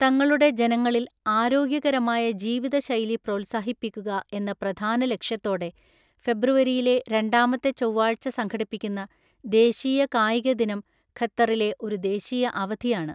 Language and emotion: Malayalam, neutral